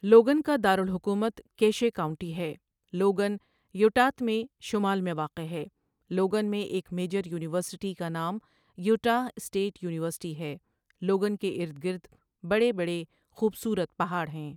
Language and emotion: Urdu, neutral